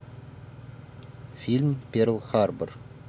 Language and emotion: Russian, neutral